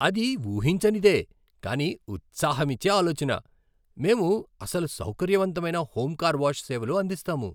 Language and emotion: Telugu, surprised